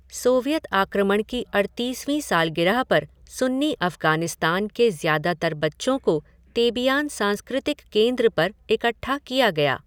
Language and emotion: Hindi, neutral